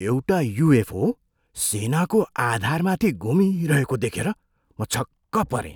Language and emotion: Nepali, surprised